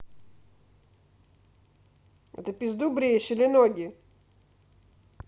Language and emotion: Russian, angry